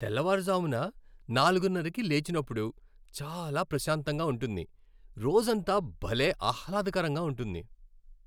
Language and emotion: Telugu, happy